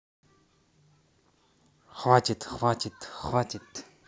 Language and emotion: Russian, neutral